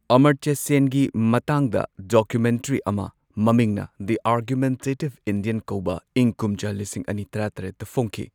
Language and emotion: Manipuri, neutral